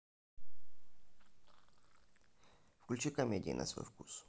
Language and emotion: Russian, neutral